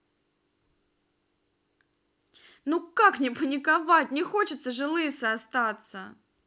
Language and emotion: Russian, angry